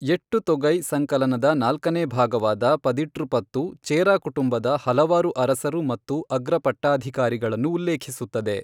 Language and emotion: Kannada, neutral